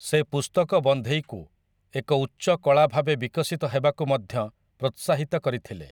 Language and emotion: Odia, neutral